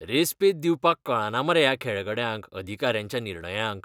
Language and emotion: Goan Konkani, disgusted